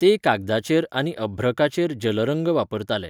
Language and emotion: Goan Konkani, neutral